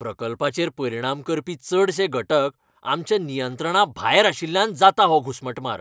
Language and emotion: Goan Konkani, angry